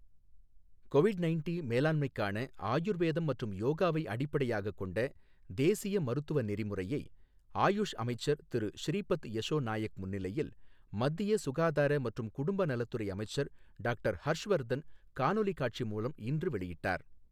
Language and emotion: Tamil, neutral